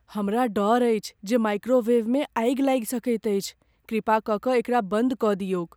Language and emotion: Maithili, fearful